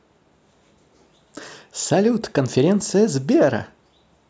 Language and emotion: Russian, positive